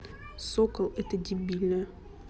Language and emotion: Russian, angry